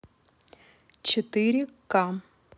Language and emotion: Russian, neutral